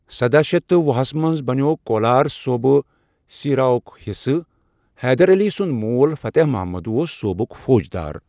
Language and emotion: Kashmiri, neutral